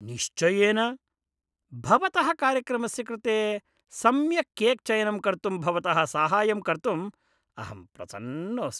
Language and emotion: Sanskrit, disgusted